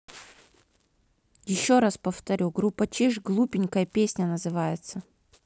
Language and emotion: Russian, neutral